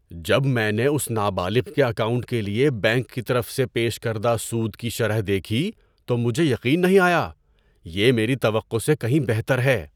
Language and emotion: Urdu, surprised